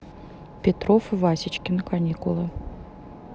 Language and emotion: Russian, neutral